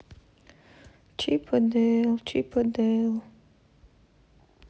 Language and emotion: Russian, sad